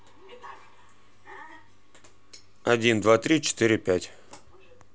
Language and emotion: Russian, neutral